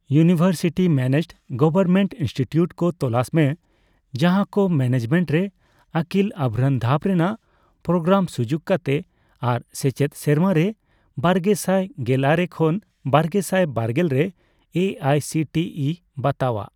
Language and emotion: Santali, neutral